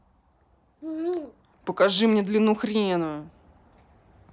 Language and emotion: Russian, angry